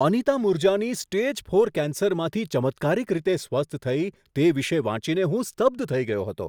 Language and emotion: Gujarati, surprised